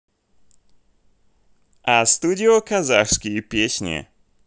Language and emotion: Russian, positive